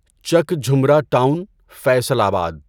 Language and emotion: Urdu, neutral